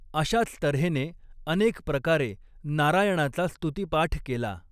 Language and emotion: Marathi, neutral